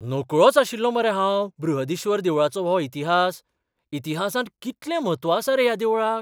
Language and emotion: Goan Konkani, surprised